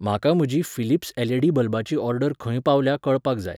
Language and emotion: Goan Konkani, neutral